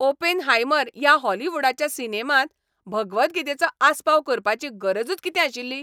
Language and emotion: Goan Konkani, angry